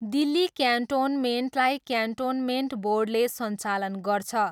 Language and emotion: Nepali, neutral